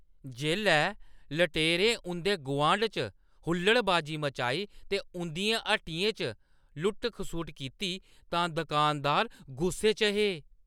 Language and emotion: Dogri, angry